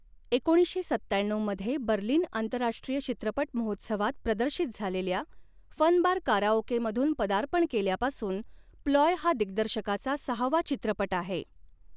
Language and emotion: Marathi, neutral